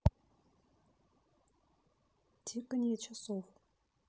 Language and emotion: Russian, neutral